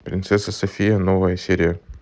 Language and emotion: Russian, neutral